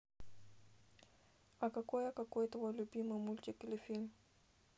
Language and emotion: Russian, neutral